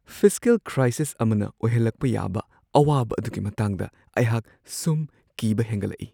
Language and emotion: Manipuri, fearful